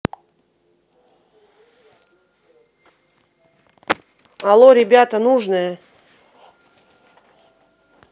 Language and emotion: Russian, neutral